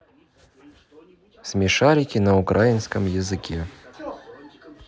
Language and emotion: Russian, neutral